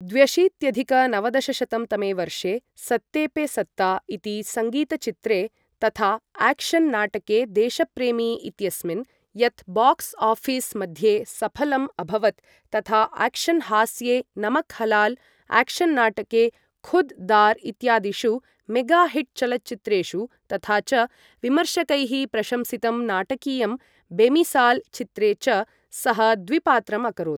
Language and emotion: Sanskrit, neutral